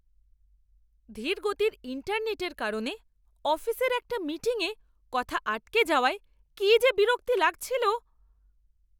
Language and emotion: Bengali, angry